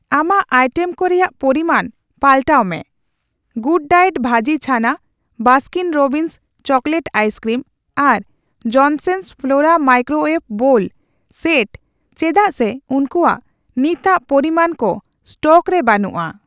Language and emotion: Santali, neutral